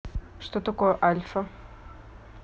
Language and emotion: Russian, neutral